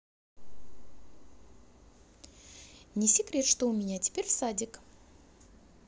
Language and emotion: Russian, positive